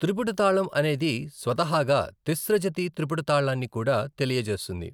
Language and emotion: Telugu, neutral